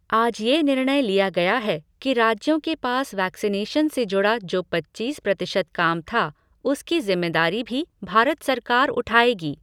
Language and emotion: Hindi, neutral